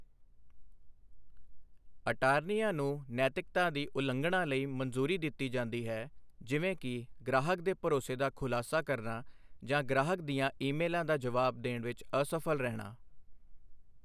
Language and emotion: Punjabi, neutral